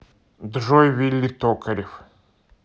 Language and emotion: Russian, neutral